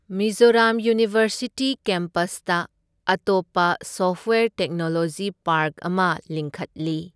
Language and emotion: Manipuri, neutral